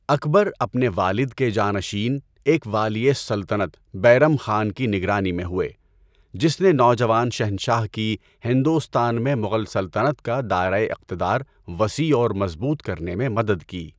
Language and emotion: Urdu, neutral